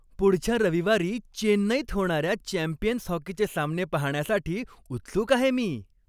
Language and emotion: Marathi, happy